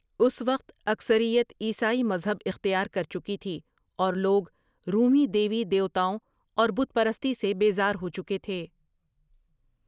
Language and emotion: Urdu, neutral